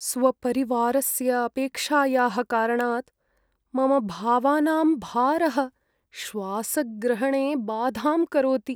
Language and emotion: Sanskrit, sad